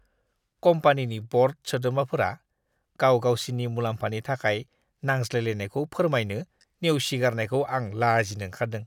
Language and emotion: Bodo, disgusted